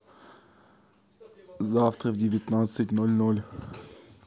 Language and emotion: Russian, neutral